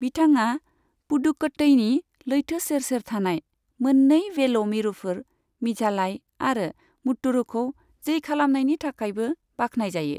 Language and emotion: Bodo, neutral